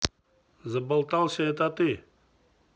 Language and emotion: Russian, neutral